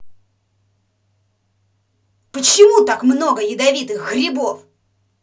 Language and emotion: Russian, angry